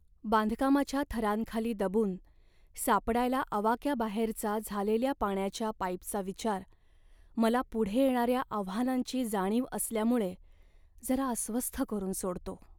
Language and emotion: Marathi, sad